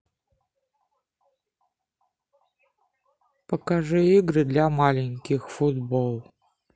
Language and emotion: Russian, neutral